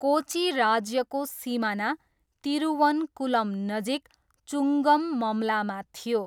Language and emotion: Nepali, neutral